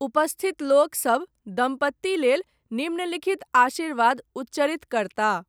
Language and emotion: Maithili, neutral